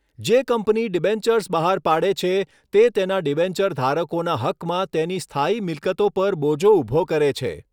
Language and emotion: Gujarati, neutral